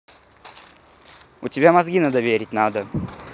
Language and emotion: Russian, angry